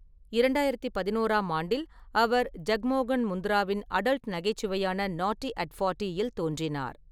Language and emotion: Tamil, neutral